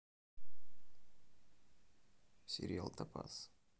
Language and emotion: Russian, neutral